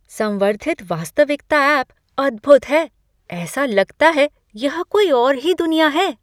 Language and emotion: Hindi, surprised